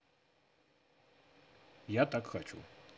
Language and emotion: Russian, neutral